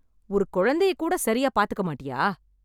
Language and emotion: Tamil, angry